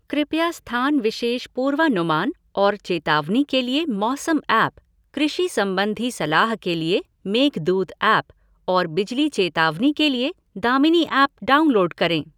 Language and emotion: Hindi, neutral